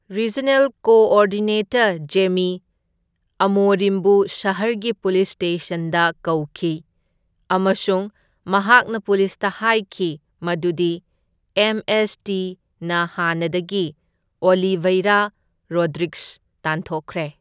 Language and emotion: Manipuri, neutral